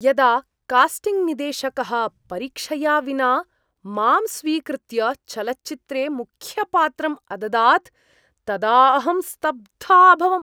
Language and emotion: Sanskrit, surprised